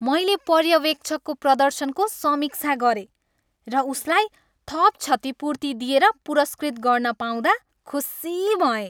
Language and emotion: Nepali, happy